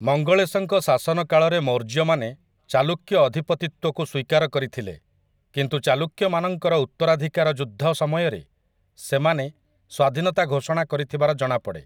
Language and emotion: Odia, neutral